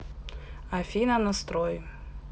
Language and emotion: Russian, neutral